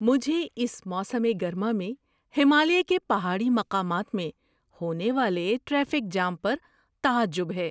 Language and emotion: Urdu, surprised